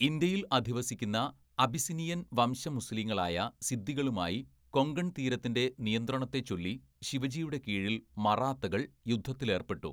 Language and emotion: Malayalam, neutral